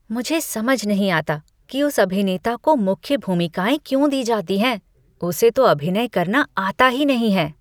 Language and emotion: Hindi, disgusted